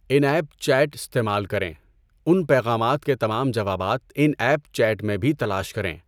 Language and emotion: Urdu, neutral